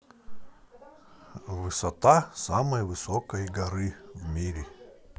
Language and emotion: Russian, neutral